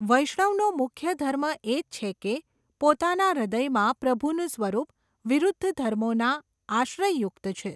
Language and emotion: Gujarati, neutral